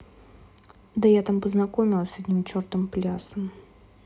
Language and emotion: Russian, neutral